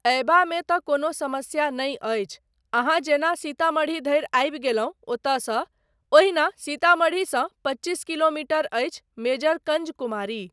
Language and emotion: Maithili, neutral